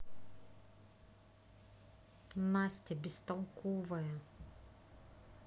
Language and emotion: Russian, angry